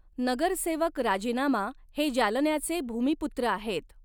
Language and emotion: Marathi, neutral